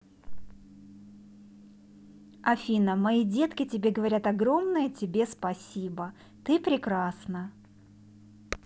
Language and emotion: Russian, positive